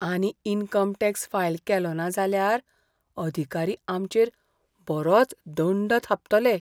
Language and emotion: Goan Konkani, fearful